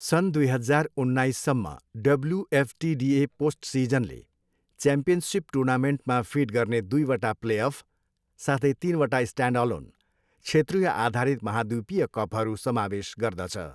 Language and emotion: Nepali, neutral